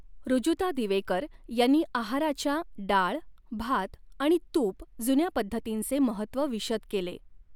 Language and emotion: Marathi, neutral